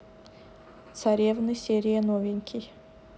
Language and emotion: Russian, neutral